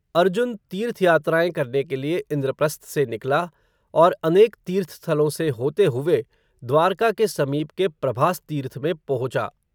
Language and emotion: Hindi, neutral